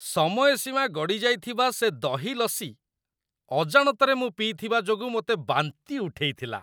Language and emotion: Odia, disgusted